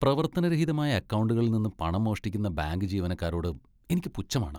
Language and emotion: Malayalam, disgusted